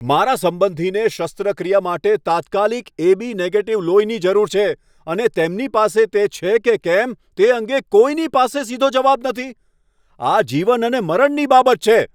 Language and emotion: Gujarati, angry